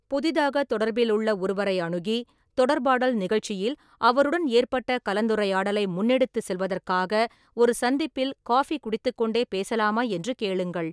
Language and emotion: Tamil, neutral